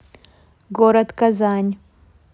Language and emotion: Russian, neutral